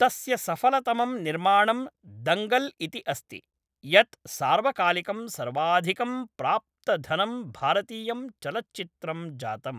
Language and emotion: Sanskrit, neutral